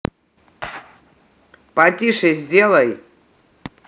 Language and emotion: Russian, angry